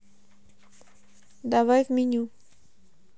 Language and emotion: Russian, neutral